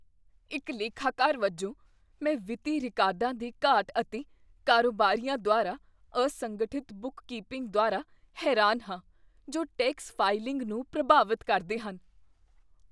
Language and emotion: Punjabi, disgusted